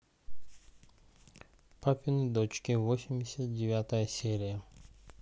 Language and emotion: Russian, neutral